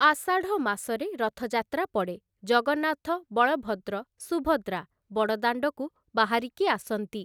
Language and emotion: Odia, neutral